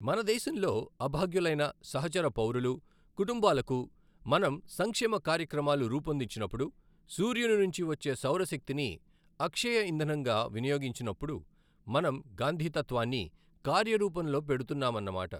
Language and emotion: Telugu, neutral